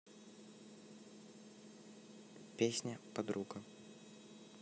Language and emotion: Russian, neutral